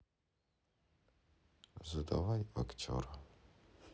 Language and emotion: Russian, sad